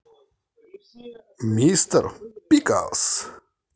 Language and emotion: Russian, positive